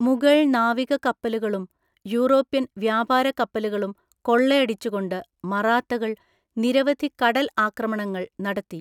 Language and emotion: Malayalam, neutral